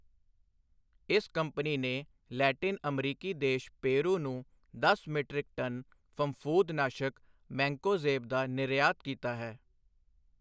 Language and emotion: Punjabi, neutral